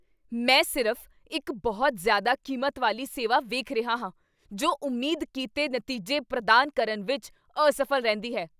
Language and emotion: Punjabi, angry